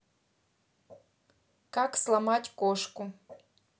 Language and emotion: Russian, neutral